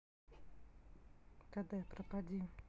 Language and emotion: Russian, neutral